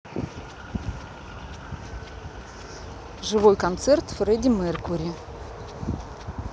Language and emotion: Russian, neutral